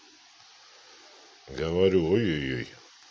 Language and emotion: Russian, neutral